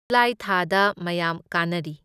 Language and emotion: Manipuri, neutral